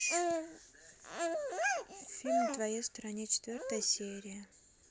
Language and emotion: Russian, neutral